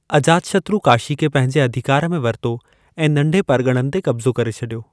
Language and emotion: Sindhi, neutral